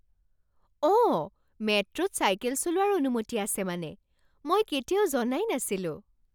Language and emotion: Assamese, surprised